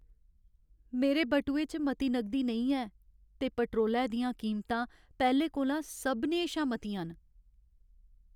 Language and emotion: Dogri, sad